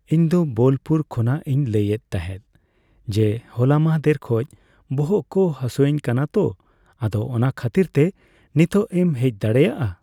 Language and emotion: Santali, neutral